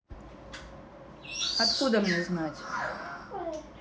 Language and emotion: Russian, neutral